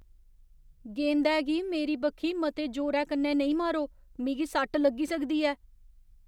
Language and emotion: Dogri, fearful